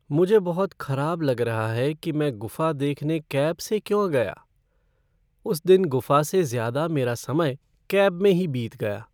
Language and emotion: Hindi, sad